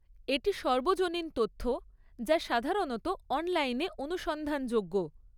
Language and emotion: Bengali, neutral